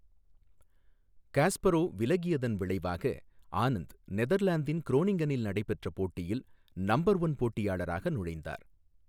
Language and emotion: Tamil, neutral